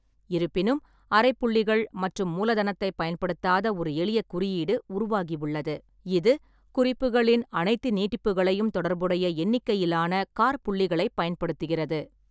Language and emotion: Tamil, neutral